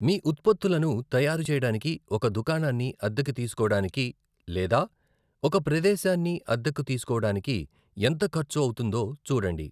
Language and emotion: Telugu, neutral